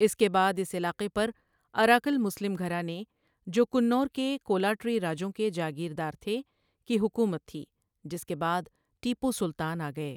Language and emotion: Urdu, neutral